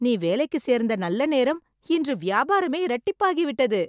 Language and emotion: Tamil, happy